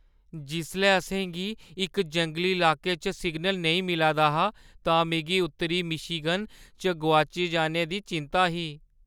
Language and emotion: Dogri, fearful